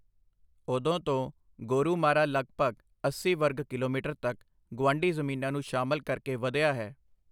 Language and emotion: Punjabi, neutral